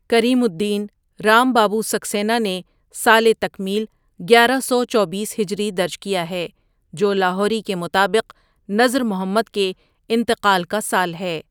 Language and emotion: Urdu, neutral